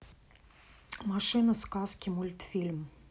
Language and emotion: Russian, neutral